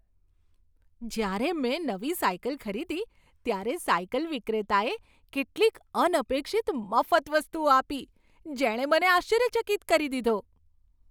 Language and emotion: Gujarati, surprised